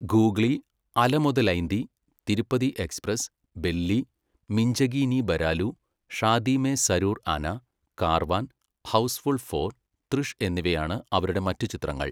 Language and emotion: Malayalam, neutral